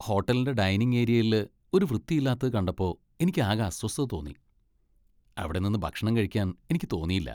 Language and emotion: Malayalam, disgusted